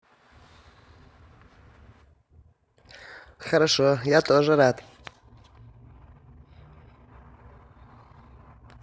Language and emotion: Russian, positive